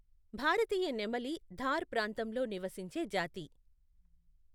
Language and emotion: Telugu, neutral